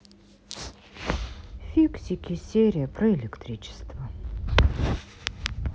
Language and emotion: Russian, sad